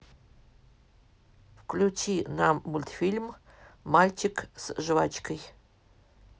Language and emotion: Russian, neutral